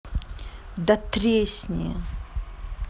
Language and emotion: Russian, angry